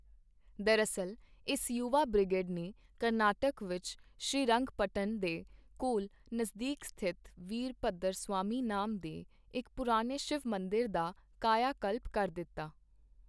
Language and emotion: Punjabi, neutral